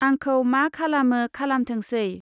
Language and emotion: Bodo, neutral